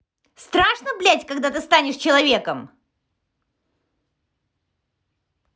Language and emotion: Russian, angry